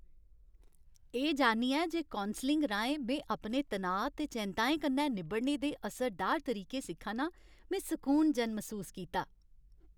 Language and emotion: Dogri, happy